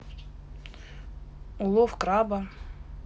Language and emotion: Russian, neutral